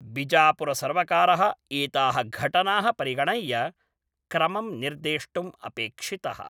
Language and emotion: Sanskrit, neutral